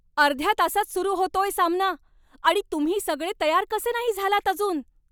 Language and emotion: Marathi, angry